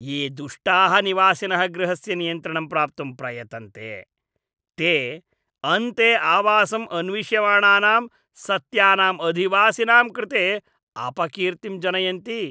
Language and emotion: Sanskrit, disgusted